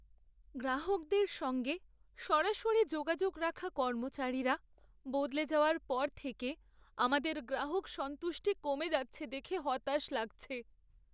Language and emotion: Bengali, sad